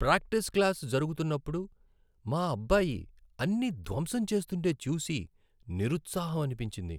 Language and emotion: Telugu, sad